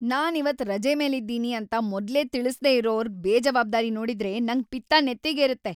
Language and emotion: Kannada, angry